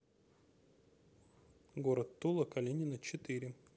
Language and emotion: Russian, neutral